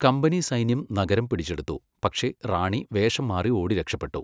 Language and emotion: Malayalam, neutral